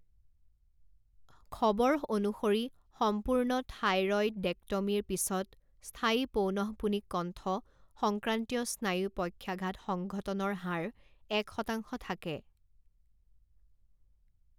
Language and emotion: Assamese, neutral